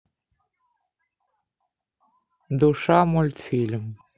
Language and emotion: Russian, neutral